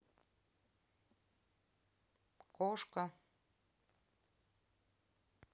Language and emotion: Russian, neutral